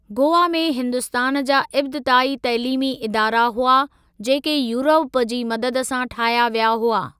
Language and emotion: Sindhi, neutral